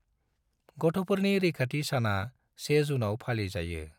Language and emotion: Bodo, neutral